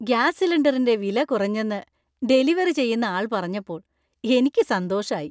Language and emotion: Malayalam, happy